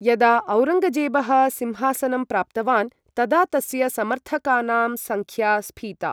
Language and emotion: Sanskrit, neutral